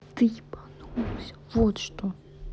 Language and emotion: Russian, angry